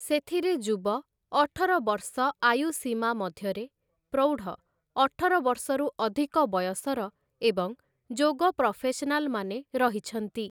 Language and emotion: Odia, neutral